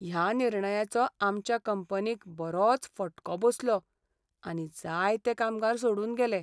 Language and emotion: Goan Konkani, sad